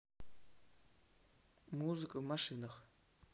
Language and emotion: Russian, neutral